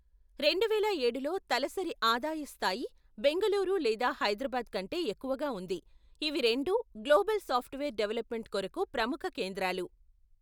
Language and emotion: Telugu, neutral